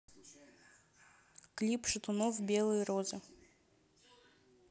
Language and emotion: Russian, neutral